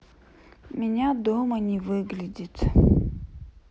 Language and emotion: Russian, sad